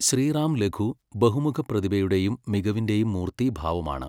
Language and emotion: Malayalam, neutral